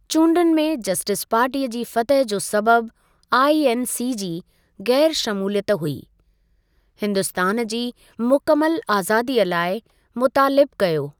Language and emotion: Sindhi, neutral